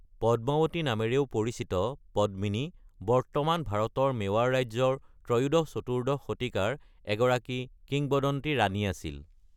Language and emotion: Assamese, neutral